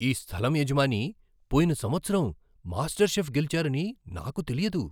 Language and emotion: Telugu, surprised